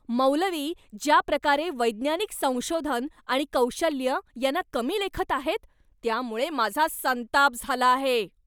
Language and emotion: Marathi, angry